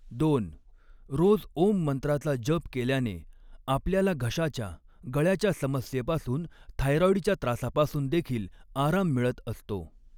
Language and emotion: Marathi, neutral